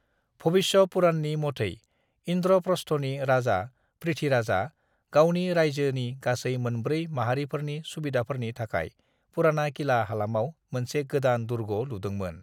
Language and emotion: Bodo, neutral